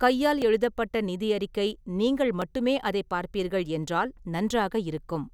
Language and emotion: Tamil, neutral